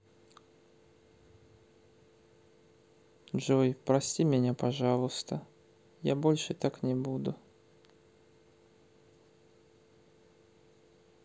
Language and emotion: Russian, sad